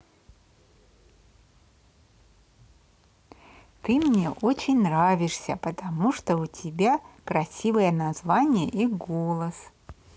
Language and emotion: Russian, positive